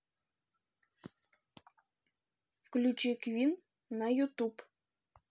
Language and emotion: Russian, neutral